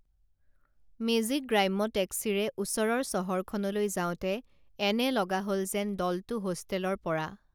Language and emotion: Assamese, neutral